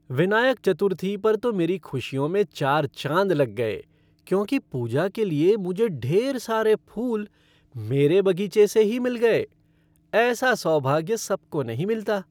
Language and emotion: Hindi, happy